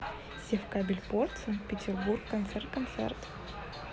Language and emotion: Russian, neutral